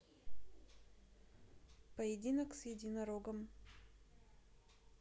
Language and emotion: Russian, neutral